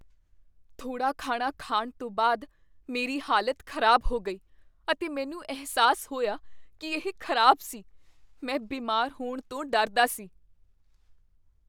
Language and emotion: Punjabi, fearful